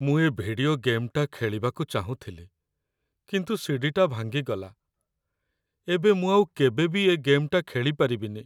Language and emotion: Odia, sad